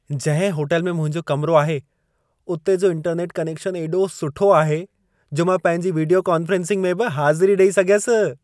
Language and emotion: Sindhi, happy